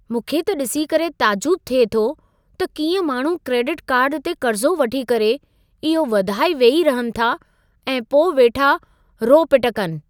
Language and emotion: Sindhi, surprised